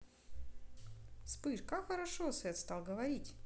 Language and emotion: Russian, neutral